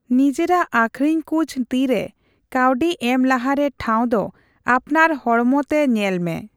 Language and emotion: Santali, neutral